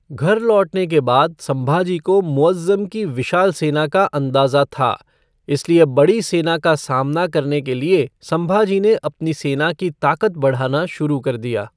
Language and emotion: Hindi, neutral